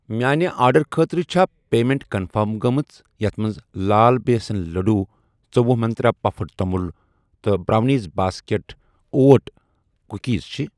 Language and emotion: Kashmiri, neutral